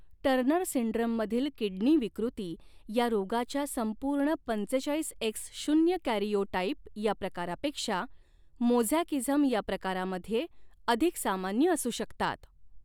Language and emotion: Marathi, neutral